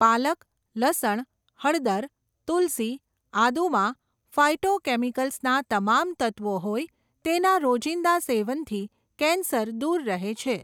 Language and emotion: Gujarati, neutral